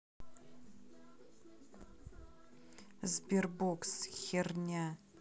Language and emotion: Russian, neutral